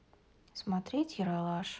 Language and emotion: Russian, sad